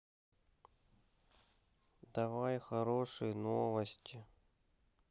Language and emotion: Russian, sad